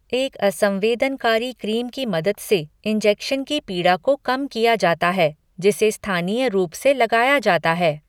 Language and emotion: Hindi, neutral